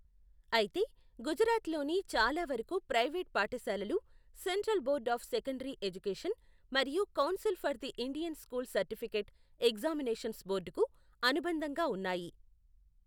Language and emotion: Telugu, neutral